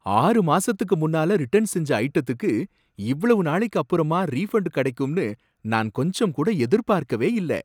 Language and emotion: Tamil, surprised